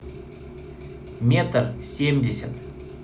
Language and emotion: Russian, neutral